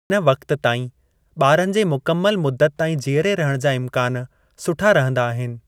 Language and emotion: Sindhi, neutral